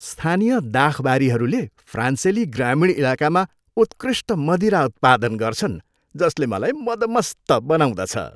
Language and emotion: Nepali, happy